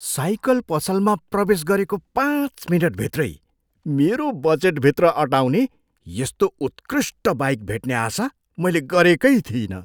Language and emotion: Nepali, surprised